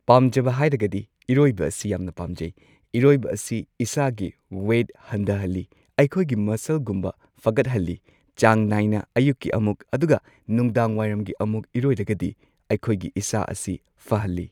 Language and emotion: Manipuri, neutral